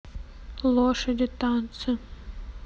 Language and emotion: Russian, neutral